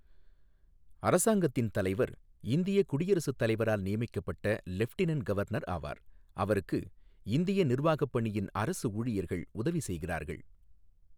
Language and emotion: Tamil, neutral